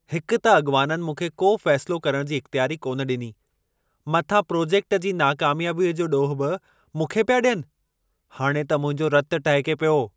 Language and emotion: Sindhi, angry